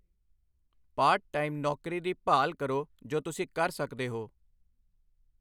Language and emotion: Punjabi, neutral